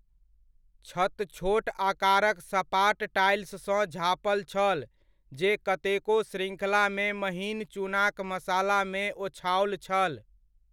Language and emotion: Maithili, neutral